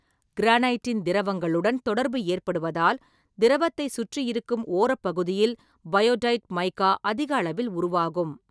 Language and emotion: Tamil, neutral